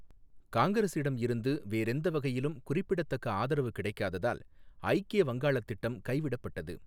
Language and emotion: Tamil, neutral